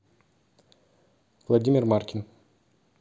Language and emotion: Russian, neutral